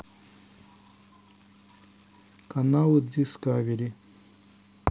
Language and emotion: Russian, neutral